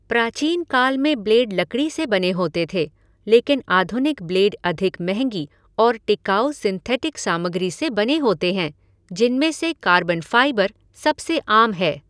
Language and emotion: Hindi, neutral